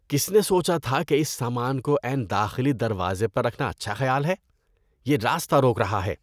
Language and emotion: Urdu, disgusted